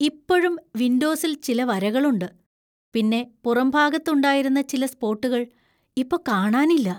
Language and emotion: Malayalam, fearful